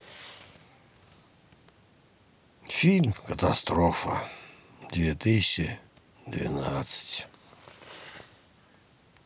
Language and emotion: Russian, sad